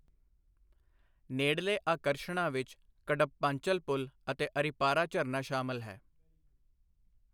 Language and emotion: Punjabi, neutral